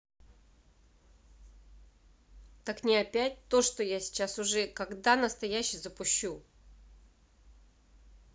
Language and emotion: Russian, angry